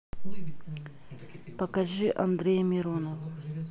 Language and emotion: Russian, neutral